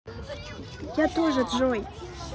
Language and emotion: Russian, positive